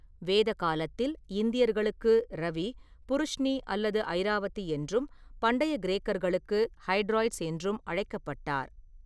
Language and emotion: Tamil, neutral